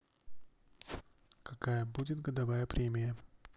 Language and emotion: Russian, neutral